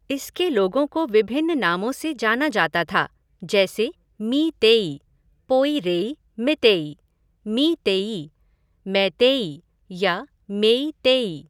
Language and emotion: Hindi, neutral